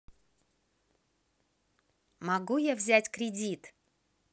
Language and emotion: Russian, positive